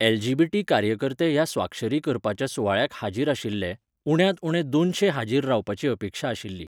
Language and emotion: Goan Konkani, neutral